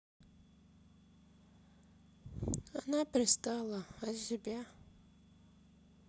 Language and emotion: Russian, sad